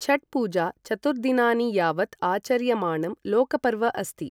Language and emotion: Sanskrit, neutral